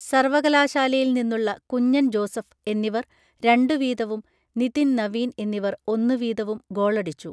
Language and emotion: Malayalam, neutral